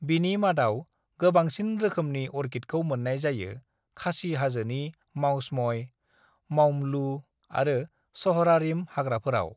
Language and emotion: Bodo, neutral